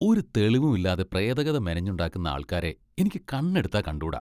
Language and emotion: Malayalam, disgusted